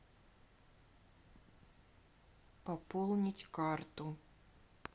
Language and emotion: Russian, neutral